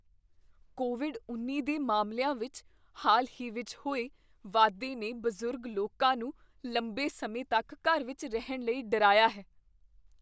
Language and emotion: Punjabi, fearful